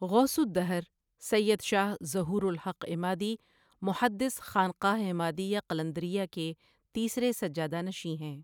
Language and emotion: Urdu, neutral